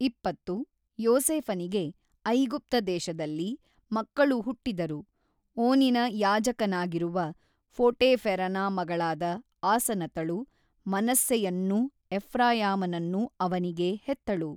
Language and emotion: Kannada, neutral